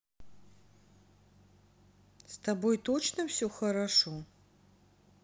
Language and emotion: Russian, neutral